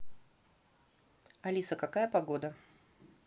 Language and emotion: Russian, neutral